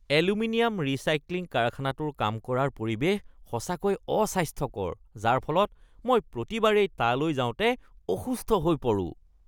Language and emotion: Assamese, disgusted